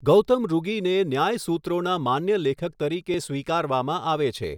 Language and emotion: Gujarati, neutral